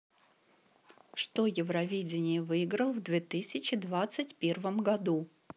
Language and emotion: Russian, neutral